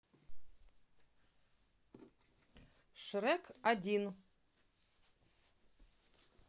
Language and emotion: Russian, neutral